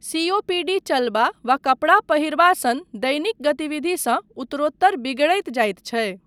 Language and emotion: Maithili, neutral